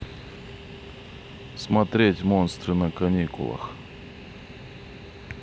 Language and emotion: Russian, neutral